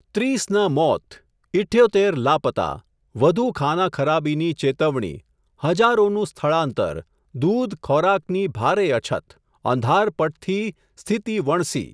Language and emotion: Gujarati, neutral